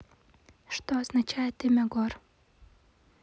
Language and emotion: Russian, neutral